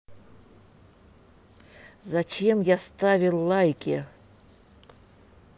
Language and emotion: Russian, angry